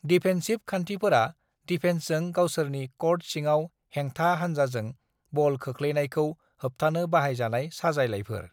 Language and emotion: Bodo, neutral